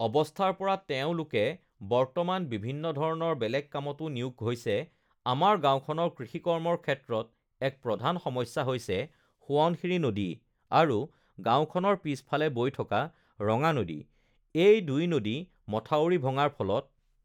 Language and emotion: Assamese, neutral